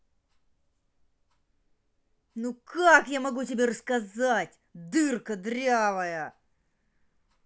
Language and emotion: Russian, angry